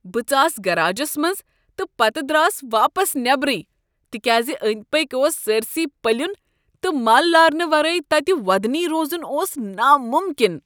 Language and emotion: Kashmiri, disgusted